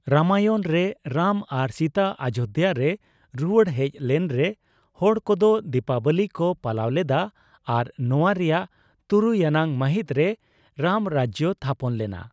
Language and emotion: Santali, neutral